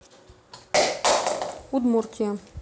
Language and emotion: Russian, neutral